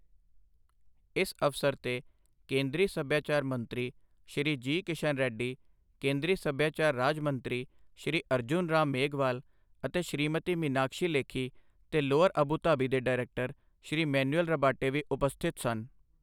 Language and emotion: Punjabi, neutral